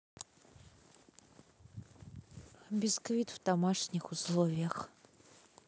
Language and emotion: Russian, neutral